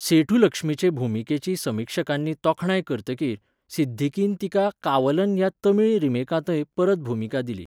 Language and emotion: Goan Konkani, neutral